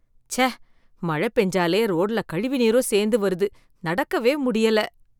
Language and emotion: Tamil, disgusted